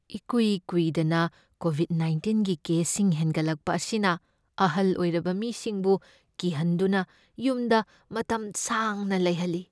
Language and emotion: Manipuri, fearful